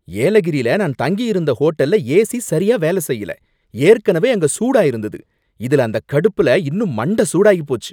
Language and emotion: Tamil, angry